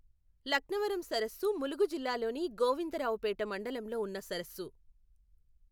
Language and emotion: Telugu, neutral